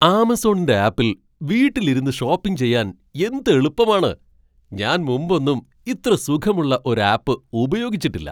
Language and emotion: Malayalam, surprised